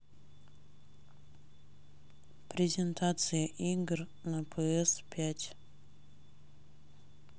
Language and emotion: Russian, neutral